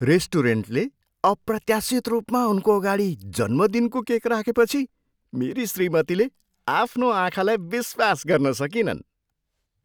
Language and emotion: Nepali, surprised